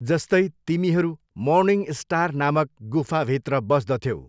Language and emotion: Nepali, neutral